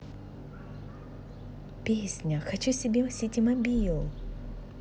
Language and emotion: Russian, positive